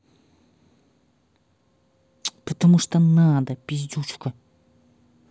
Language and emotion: Russian, angry